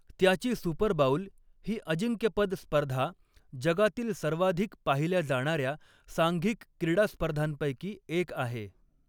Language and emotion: Marathi, neutral